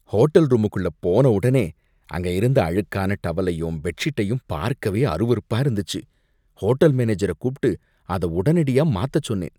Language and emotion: Tamil, disgusted